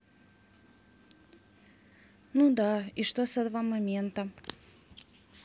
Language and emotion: Russian, neutral